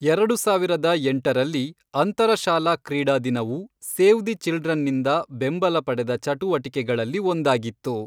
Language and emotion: Kannada, neutral